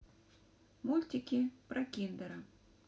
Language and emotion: Russian, neutral